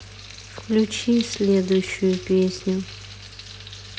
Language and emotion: Russian, sad